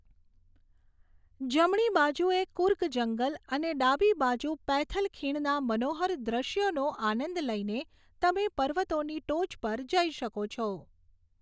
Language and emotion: Gujarati, neutral